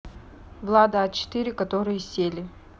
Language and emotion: Russian, neutral